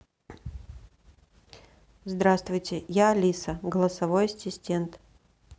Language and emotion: Russian, neutral